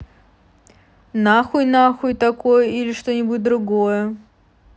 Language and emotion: Russian, neutral